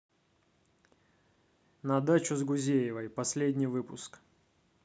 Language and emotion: Russian, neutral